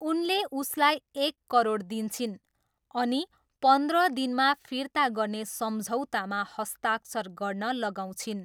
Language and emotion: Nepali, neutral